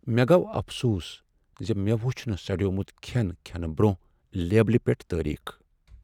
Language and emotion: Kashmiri, sad